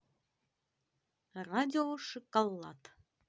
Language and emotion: Russian, positive